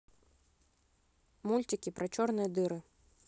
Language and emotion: Russian, neutral